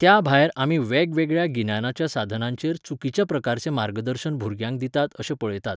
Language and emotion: Goan Konkani, neutral